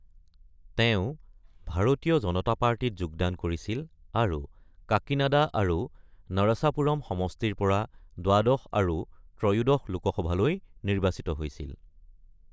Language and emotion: Assamese, neutral